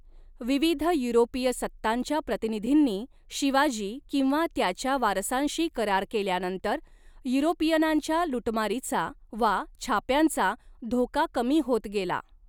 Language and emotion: Marathi, neutral